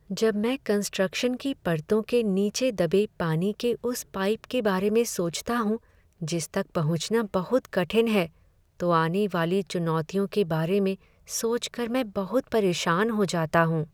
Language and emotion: Hindi, sad